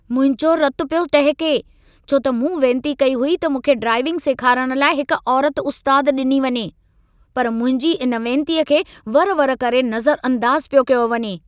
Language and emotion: Sindhi, angry